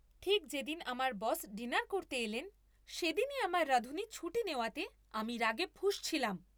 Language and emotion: Bengali, angry